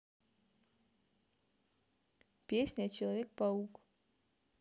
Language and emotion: Russian, neutral